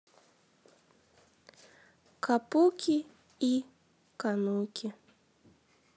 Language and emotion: Russian, sad